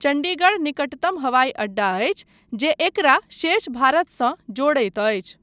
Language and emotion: Maithili, neutral